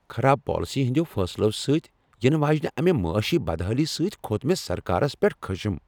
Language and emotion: Kashmiri, angry